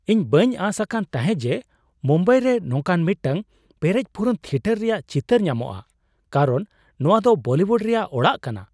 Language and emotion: Santali, surprised